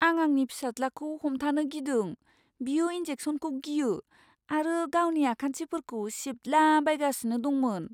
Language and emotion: Bodo, fearful